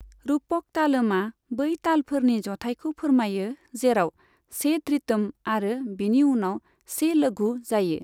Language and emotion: Bodo, neutral